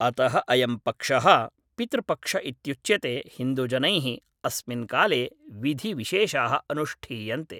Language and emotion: Sanskrit, neutral